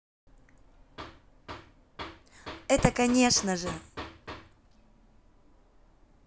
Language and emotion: Russian, positive